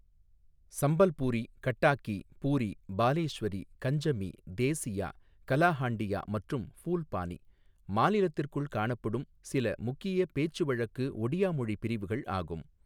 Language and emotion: Tamil, neutral